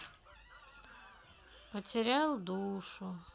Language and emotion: Russian, sad